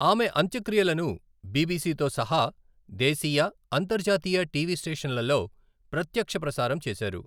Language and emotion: Telugu, neutral